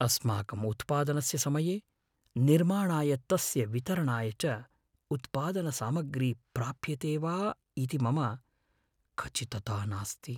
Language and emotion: Sanskrit, fearful